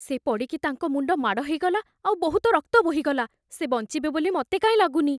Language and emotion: Odia, fearful